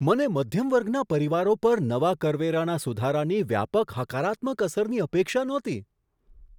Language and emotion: Gujarati, surprised